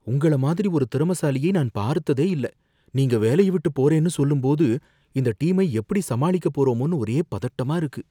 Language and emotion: Tamil, fearful